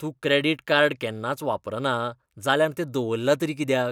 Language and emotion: Goan Konkani, disgusted